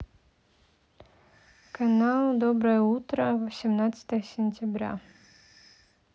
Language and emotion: Russian, neutral